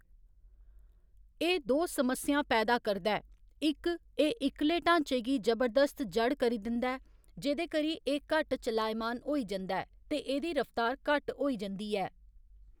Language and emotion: Dogri, neutral